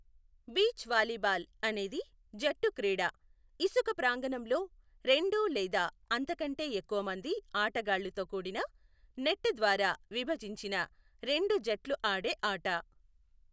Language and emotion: Telugu, neutral